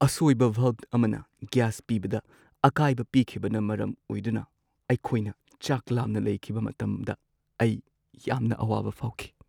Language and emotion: Manipuri, sad